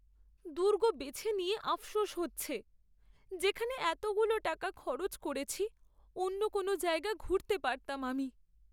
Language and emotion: Bengali, sad